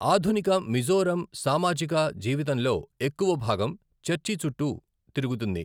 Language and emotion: Telugu, neutral